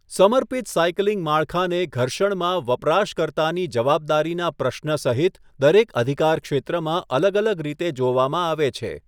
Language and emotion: Gujarati, neutral